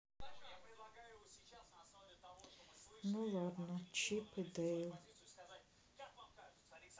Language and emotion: Russian, sad